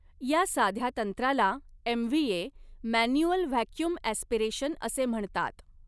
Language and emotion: Marathi, neutral